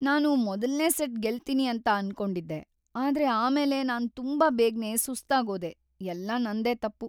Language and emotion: Kannada, sad